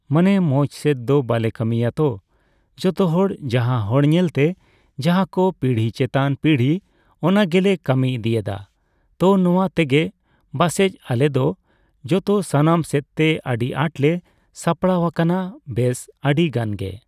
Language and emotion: Santali, neutral